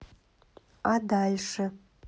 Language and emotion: Russian, neutral